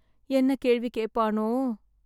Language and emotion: Tamil, sad